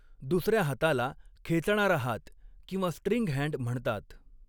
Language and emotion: Marathi, neutral